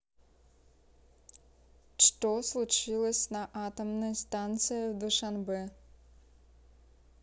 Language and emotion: Russian, neutral